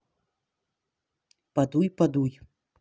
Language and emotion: Russian, neutral